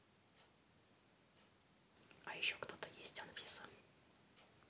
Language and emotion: Russian, neutral